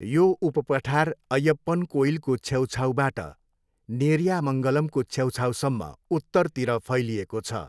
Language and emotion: Nepali, neutral